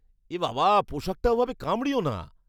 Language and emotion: Bengali, disgusted